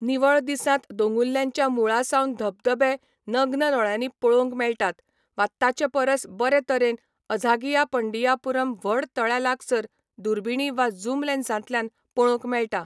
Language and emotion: Goan Konkani, neutral